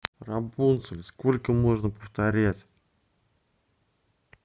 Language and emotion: Russian, angry